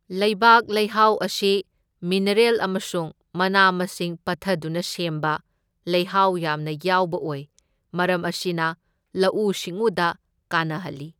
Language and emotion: Manipuri, neutral